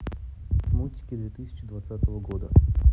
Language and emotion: Russian, neutral